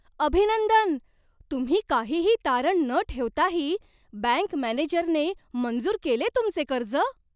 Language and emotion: Marathi, surprised